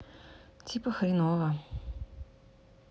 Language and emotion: Russian, sad